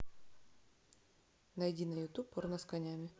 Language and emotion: Russian, neutral